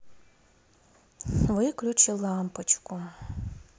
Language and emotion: Russian, sad